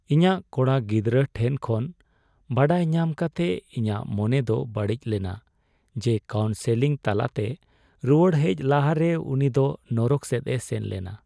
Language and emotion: Santali, sad